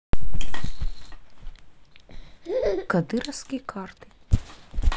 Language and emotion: Russian, neutral